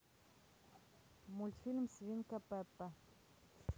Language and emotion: Russian, neutral